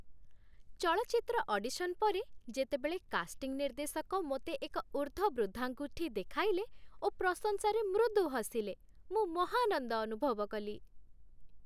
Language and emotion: Odia, happy